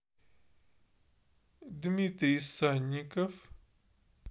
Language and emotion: Russian, neutral